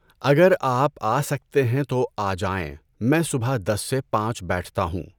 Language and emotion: Urdu, neutral